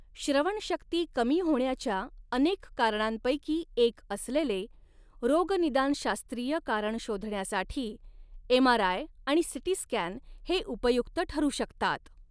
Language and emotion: Marathi, neutral